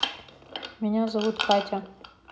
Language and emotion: Russian, neutral